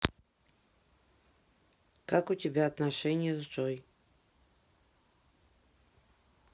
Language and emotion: Russian, neutral